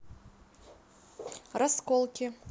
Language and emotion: Russian, neutral